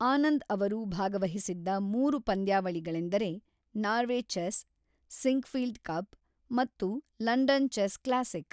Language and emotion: Kannada, neutral